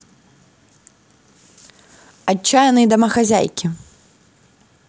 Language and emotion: Russian, positive